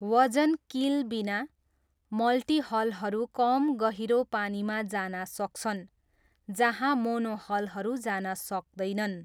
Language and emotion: Nepali, neutral